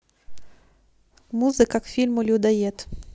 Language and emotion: Russian, neutral